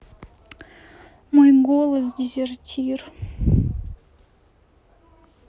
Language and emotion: Russian, sad